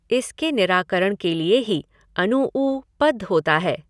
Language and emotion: Hindi, neutral